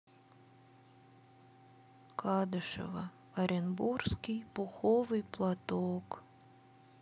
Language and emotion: Russian, sad